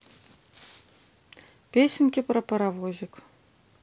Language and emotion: Russian, neutral